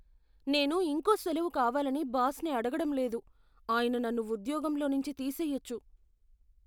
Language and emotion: Telugu, fearful